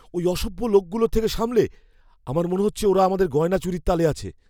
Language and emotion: Bengali, fearful